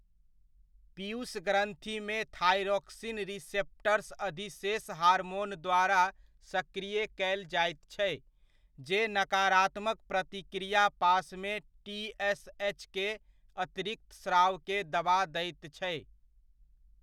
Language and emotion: Maithili, neutral